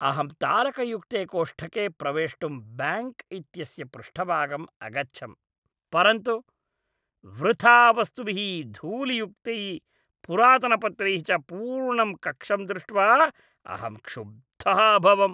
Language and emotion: Sanskrit, disgusted